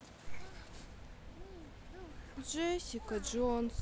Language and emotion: Russian, sad